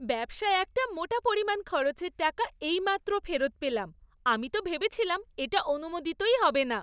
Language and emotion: Bengali, happy